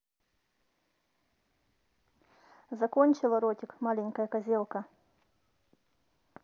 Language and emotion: Russian, neutral